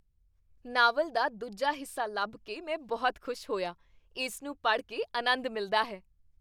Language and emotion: Punjabi, happy